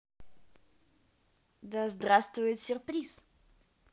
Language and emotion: Russian, positive